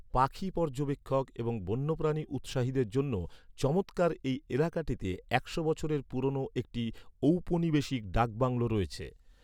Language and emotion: Bengali, neutral